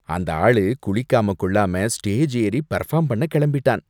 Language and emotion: Tamil, disgusted